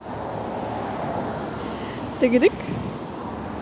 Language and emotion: Russian, positive